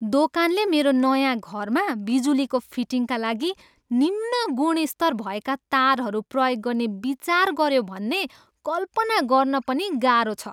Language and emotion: Nepali, disgusted